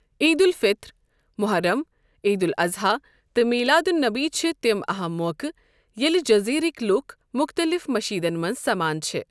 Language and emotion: Kashmiri, neutral